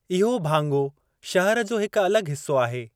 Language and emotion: Sindhi, neutral